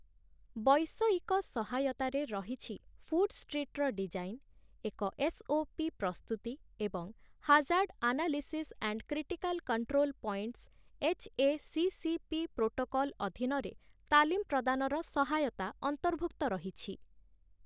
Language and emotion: Odia, neutral